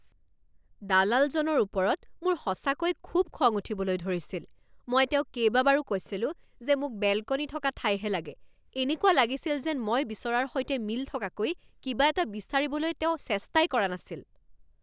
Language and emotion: Assamese, angry